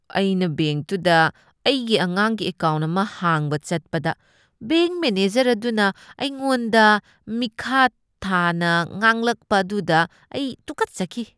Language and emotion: Manipuri, disgusted